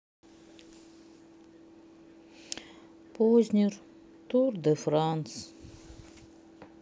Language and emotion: Russian, sad